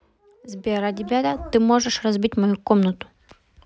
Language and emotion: Russian, neutral